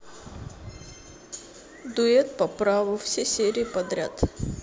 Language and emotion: Russian, neutral